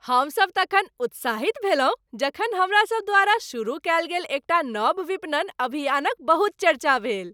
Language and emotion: Maithili, happy